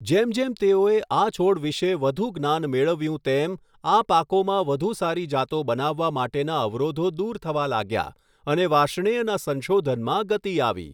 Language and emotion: Gujarati, neutral